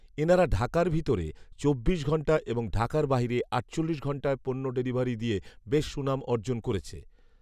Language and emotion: Bengali, neutral